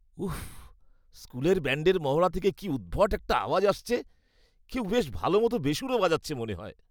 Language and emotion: Bengali, disgusted